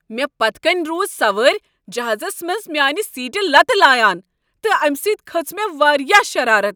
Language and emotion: Kashmiri, angry